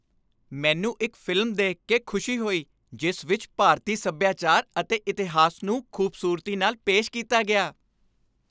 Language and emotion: Punjabi, happy